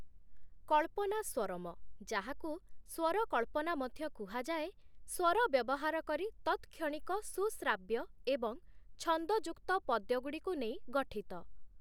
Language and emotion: Odia, neutral